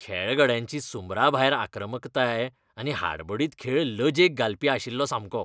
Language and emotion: Goan Konkani, disgusted